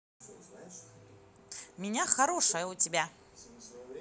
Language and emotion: Russian, positive